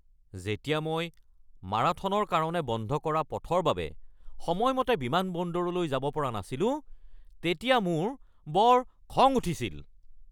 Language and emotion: Assamese, angry